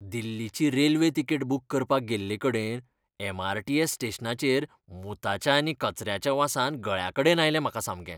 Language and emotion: Goan Konkani, disgusted